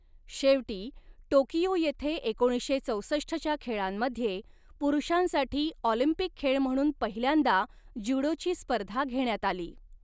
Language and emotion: Marathi, neutral